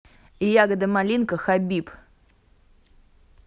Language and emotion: Russian, neutral